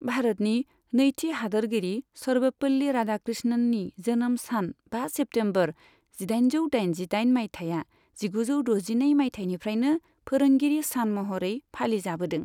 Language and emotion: Bodo, neutral